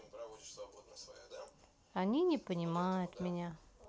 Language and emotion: Russian, sad